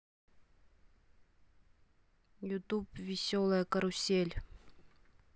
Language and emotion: Russian, neutral